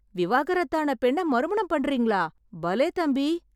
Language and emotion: Tamil, surprised